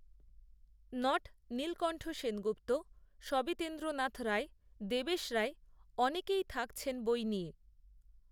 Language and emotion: Bengali, neutral